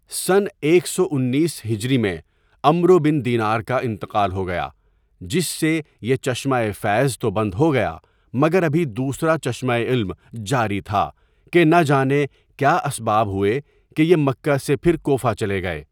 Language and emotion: Urdu, neutral